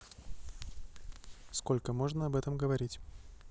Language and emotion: Russian, neutral